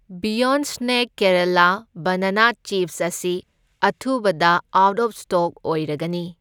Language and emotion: Manipuri, neutral